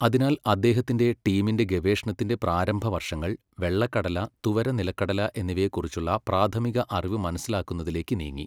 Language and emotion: Malayalam, neutral